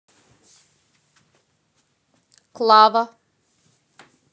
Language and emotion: Russian, neutral